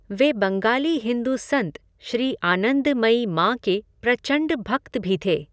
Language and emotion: Hindi, neutral